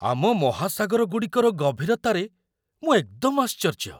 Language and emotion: Odia, surprised